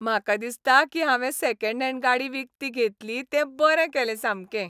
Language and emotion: Goan Konkani, happy